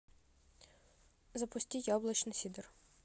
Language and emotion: Russian, neutral